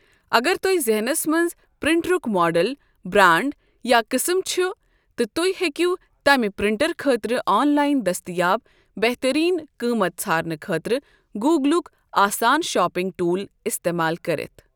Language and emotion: Kashmiri, neutral